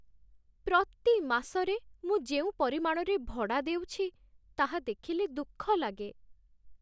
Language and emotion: Odia, sad